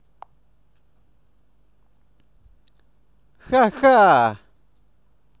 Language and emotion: Russian, positive